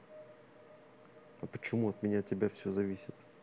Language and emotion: Russian, neutral